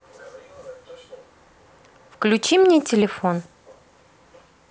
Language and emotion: Russian, neutral